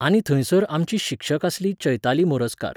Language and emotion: Goan Konkani, neutral